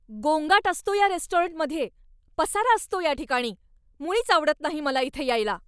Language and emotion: Marathi, angry